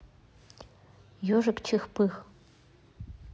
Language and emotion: Russian, neutral